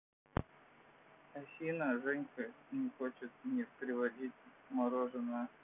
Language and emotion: Russian, sad